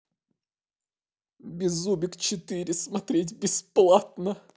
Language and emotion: Russian, sad